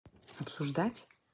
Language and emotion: Russian, neutral